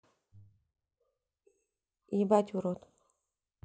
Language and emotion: Russian, neutral